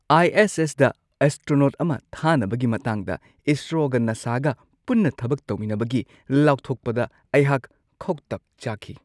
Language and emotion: Manipuri, surprised